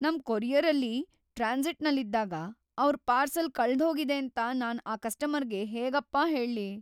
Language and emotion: Kannada, fearful